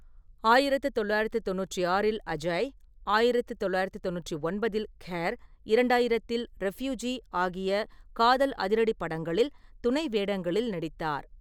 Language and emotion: Tamil, neutral